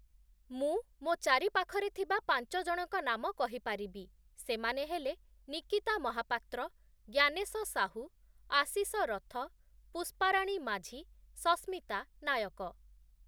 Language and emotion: Odia, neutral